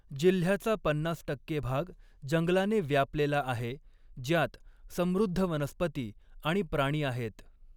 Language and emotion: Marathi, neutral